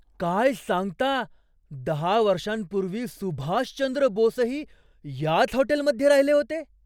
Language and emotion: Marathi, surprised